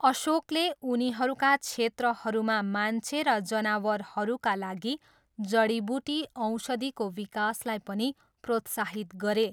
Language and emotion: Nepali, neutral